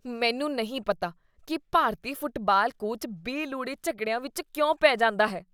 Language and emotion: Punjabi, disgusted